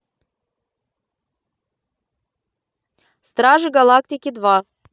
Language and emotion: Russian, positive